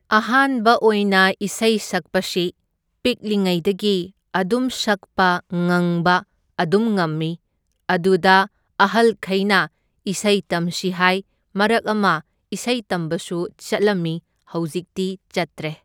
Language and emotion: Manipuri, neutral